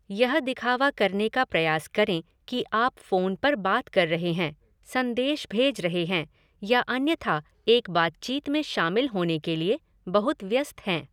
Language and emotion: Hindi, neutral